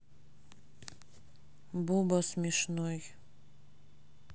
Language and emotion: Russian, neutral